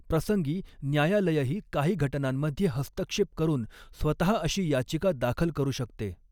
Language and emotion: Marathi, neutral